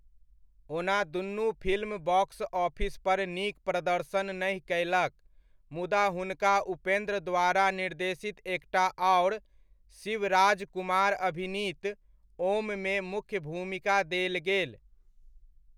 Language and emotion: Maithili, neutral